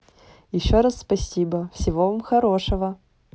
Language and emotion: Russian, positive